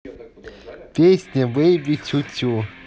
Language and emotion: Russian, positive